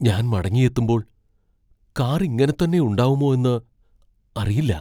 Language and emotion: Malayalam, fearful